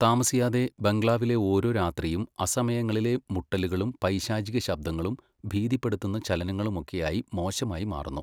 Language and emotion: Malayalam, neutral